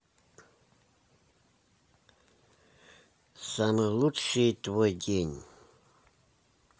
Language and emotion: Russian, neutral